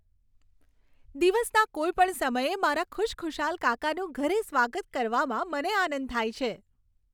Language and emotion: Gujarati, happy